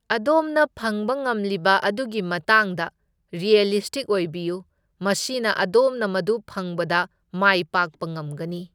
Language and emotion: Manipuri, neutral